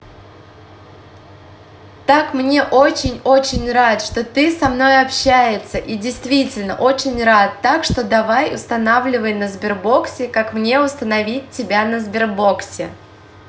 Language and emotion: Russian, positive